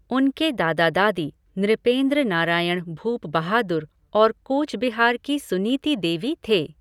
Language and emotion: Hindi, neutral